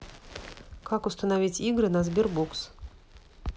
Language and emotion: Russian, neutral